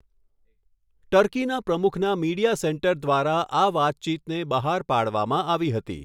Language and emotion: Gujarati, neutral